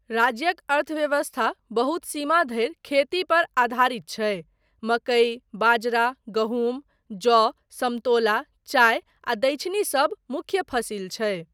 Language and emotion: Maithili, neutral